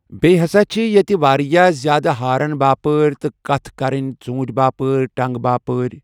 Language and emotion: Kashmiri, neutral